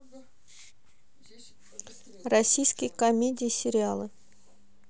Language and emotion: Russian, neutral